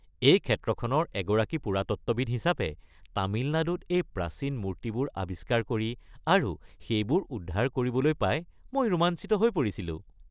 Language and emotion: Assamese, happy